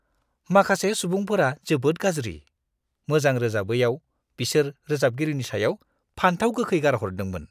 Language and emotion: Bodo, disgusted